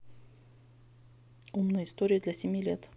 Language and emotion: Russian, neutral